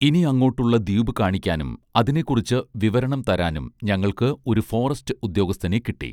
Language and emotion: Malayalam, neutral